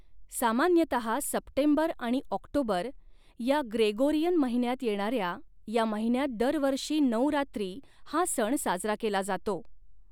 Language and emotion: Marathi, neutral